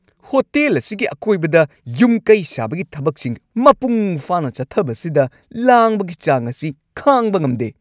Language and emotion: Manipuri, angry